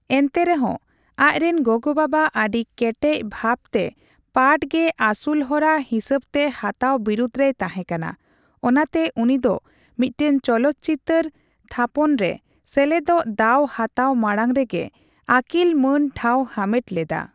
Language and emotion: Santali, neutral